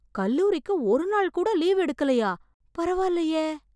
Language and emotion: Tamil, surprised